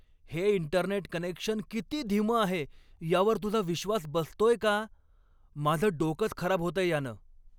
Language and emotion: Marathi, angry